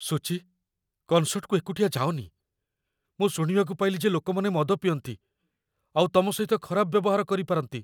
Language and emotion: Odia, fearful